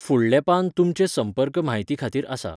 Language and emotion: Goan Konkani, neutral